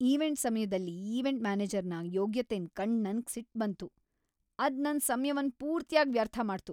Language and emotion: Kannada, angry